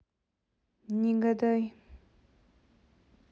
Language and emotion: Russian, neutral